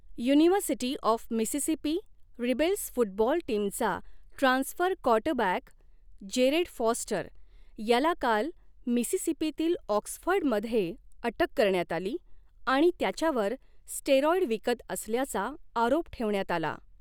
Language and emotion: Marathi, neutral